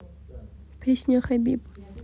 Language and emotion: Russian, neutral